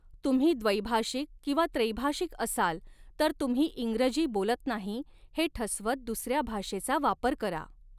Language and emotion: Marathi, neutral